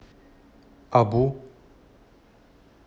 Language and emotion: Russian, neutral